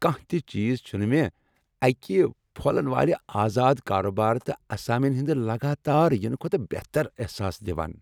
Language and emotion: Kashmiri, happy